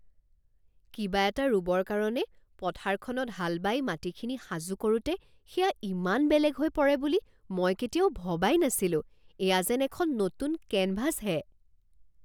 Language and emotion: Assamese, surprised